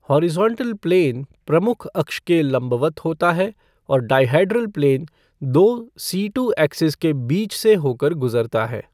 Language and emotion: Hindi, neutral